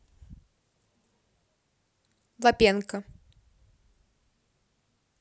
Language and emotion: Russian, neutral